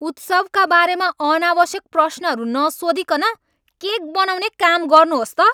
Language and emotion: Nepali, angry